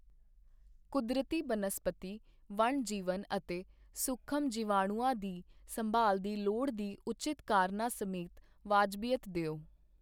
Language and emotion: Punjabi, neutral